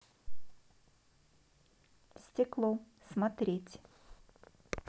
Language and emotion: Russian, neutral